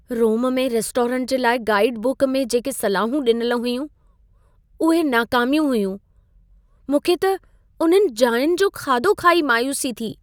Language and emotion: Sindhi, sad